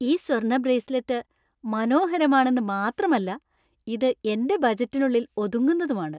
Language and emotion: Malayalam, happy